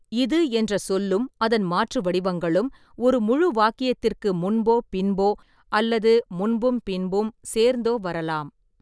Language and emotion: Tamil, neutral